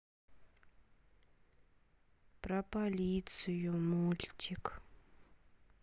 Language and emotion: Russian, sad